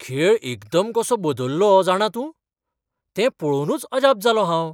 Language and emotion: Goan Konkani, surprised